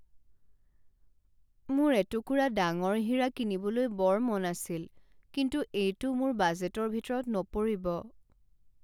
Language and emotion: Assamese, sad